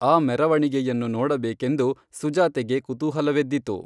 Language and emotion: Kannada, neutral